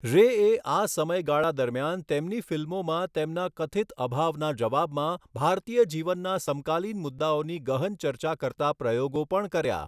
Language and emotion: Gujarati, neutral